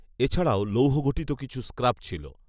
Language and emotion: Bengali, neutral